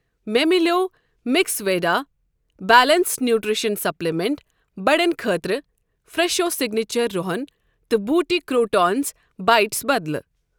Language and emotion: Kashmiri, neutral